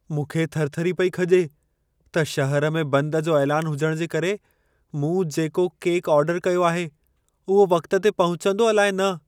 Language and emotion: Sindhi, fearful